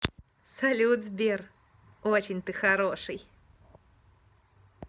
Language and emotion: Russian, positive